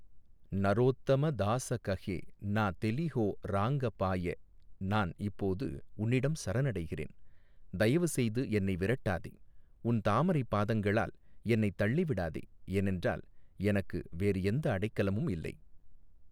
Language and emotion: Tamil, neutral